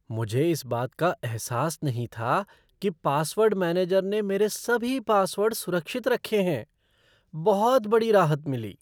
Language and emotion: Hindi, surprised